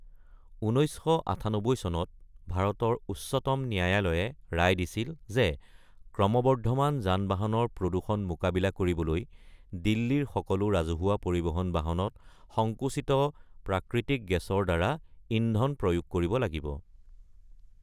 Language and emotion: Assamese, neutral